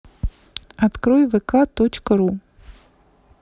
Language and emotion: Russian, neutral